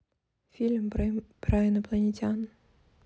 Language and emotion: Russian, neutral